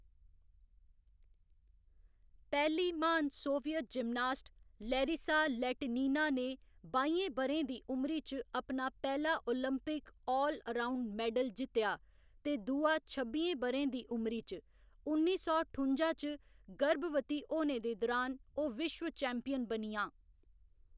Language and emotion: Dogri, neutral